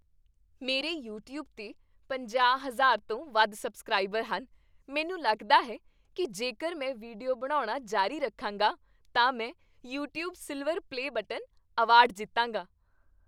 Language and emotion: Punjabi, happy